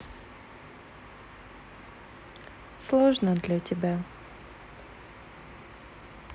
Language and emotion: Russian, sad